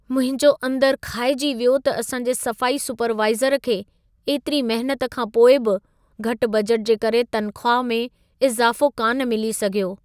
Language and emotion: Sindhi, sad